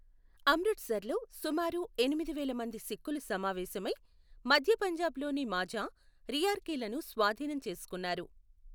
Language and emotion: Telugu, neutral